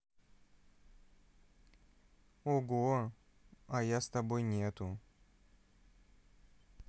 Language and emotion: Russian, neutral